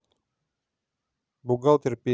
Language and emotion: Russian, neutral